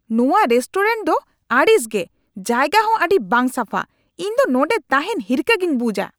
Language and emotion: Santali, angry